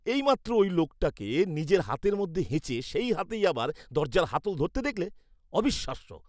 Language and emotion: Bengali, disgusted